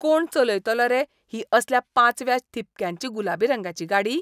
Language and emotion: Goan Konkani, disgusted